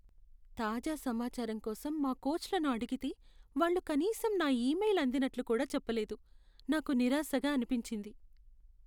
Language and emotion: Telugu, sad